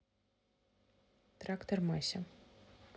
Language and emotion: Russian, neutral